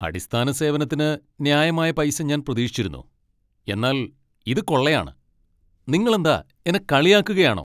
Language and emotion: Malayalam, angry